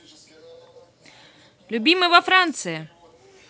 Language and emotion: Russian, positive